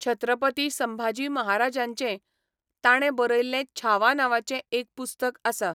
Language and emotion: Goan Konkani, neutral